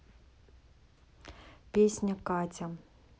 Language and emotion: Russian, neutral